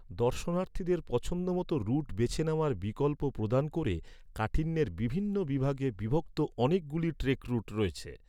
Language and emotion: Bengali, neutral